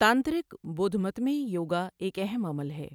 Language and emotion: Urdu, neutral